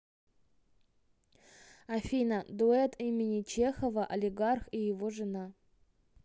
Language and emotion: Russian, neutral